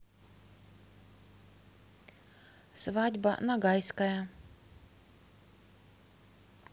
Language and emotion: Russian, neutral